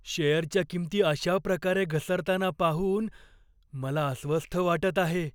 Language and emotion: Marathi, fearful